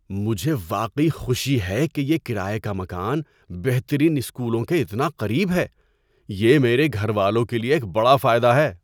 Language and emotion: Urdu, surprised